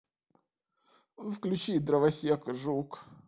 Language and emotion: Russian, neutral